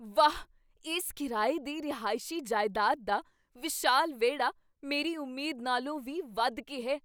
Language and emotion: Punjabi, surprised